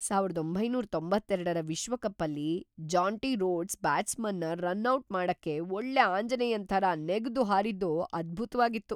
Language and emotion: Kannada, surprised